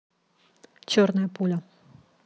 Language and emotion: Russian, neutral